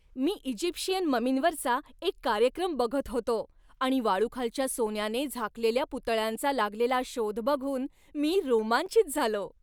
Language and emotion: Marathi, happy